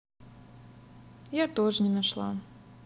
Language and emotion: Russian, sad